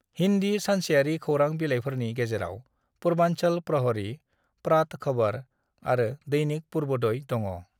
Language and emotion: Bodo, neutral